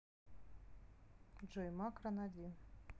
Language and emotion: Russian, neutral